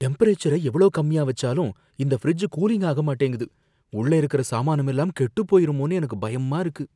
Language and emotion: Tamil, fearful